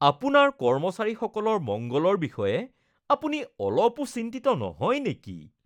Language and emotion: Assamese, disgusted